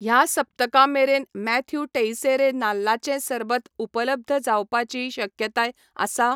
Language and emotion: Goan Konkani, neutral